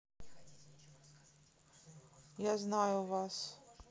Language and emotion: Russian, sad